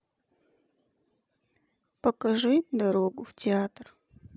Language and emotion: Russian, sad